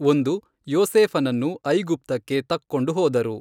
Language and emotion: Kannada, neutral